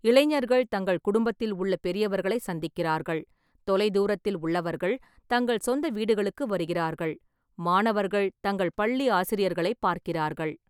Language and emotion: Tamil, neutral